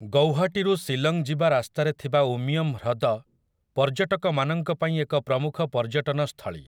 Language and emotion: Odia, neutral